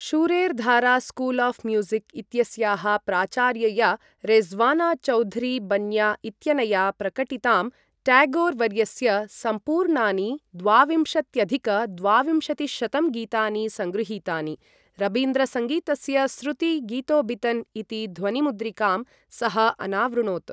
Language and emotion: Sanskrit, neutral